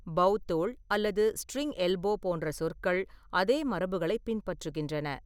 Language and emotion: Tamil, neutral